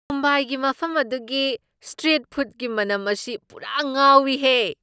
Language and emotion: Manipuri, surprised